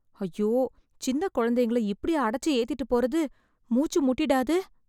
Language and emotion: Tamil, fearful